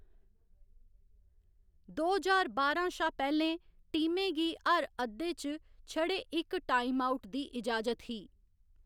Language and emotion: Dogri, neutral